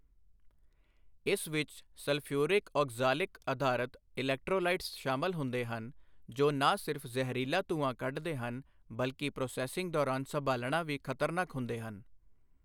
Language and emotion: Punjabi, neutral